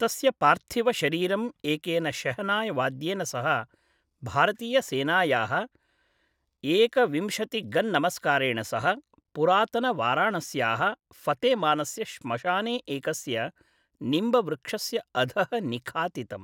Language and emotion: Sanskrit, neutral